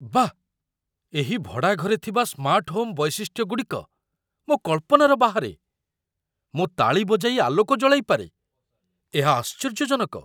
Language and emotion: Odia, surprised